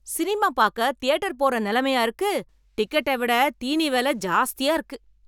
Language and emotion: Tamil, angry